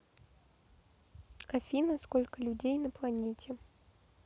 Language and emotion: Russian, neutral